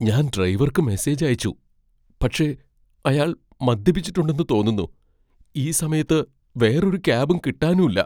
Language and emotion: Malayalam, fearful